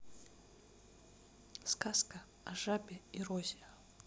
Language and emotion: Russian, neutral